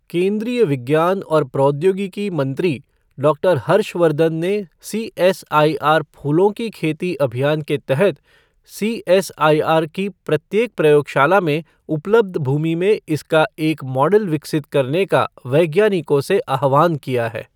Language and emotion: Hindi, neutral